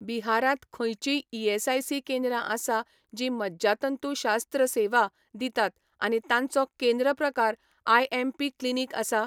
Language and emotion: Goan Konkani, neutral